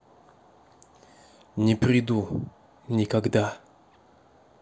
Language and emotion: Russian, neutral